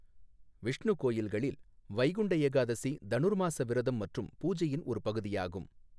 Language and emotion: Tamil, neutral